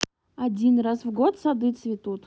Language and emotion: Russian, neutral